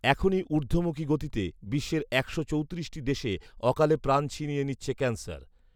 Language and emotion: Bengali, neutral